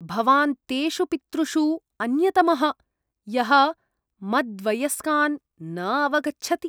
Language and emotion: Sanskrit, disgusted